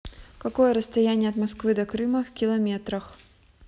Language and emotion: Russian, neutral